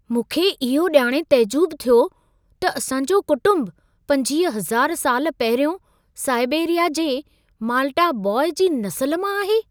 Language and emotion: Sindhi, surprised